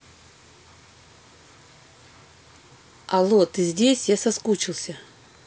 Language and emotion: Russian, neutral